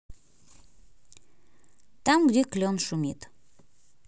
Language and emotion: Russian, neutral